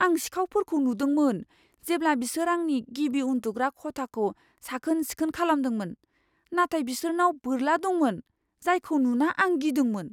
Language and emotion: Bodo, fearful